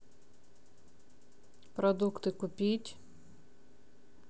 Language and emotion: Russian, neutral